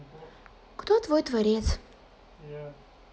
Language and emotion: Russian, neutral